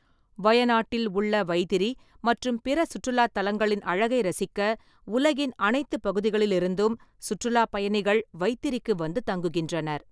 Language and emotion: Tamil, neutral